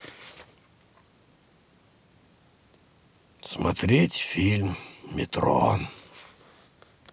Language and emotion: Russian, sad